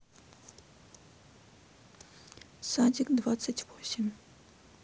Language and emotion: Russian, neutral